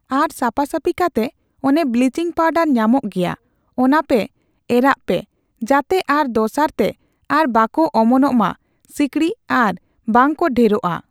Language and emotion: Santali, neutral